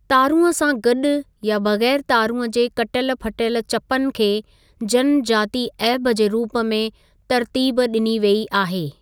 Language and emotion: Sindhi, neutral